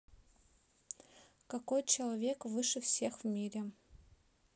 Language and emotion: Russian, neutral